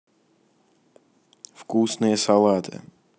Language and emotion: Russian, neutral